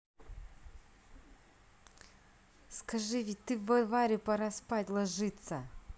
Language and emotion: Russian, angry